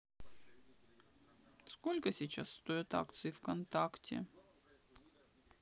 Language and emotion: Russian, sad